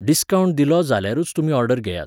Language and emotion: Goan Konkani, neutral